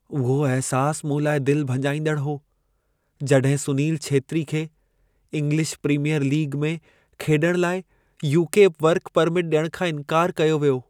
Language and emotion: Sindhi, sad